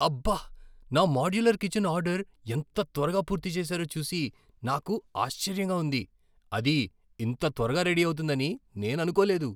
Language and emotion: Telugu, surprised